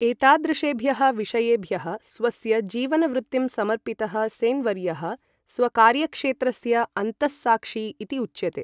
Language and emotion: Sanskrit, neutral